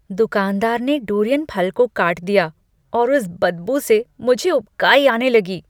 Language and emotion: Hindi, disgusted